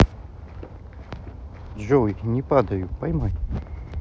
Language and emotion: Russian, neutral